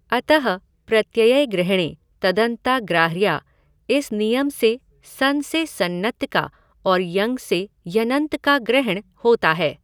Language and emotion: Hindi, neutral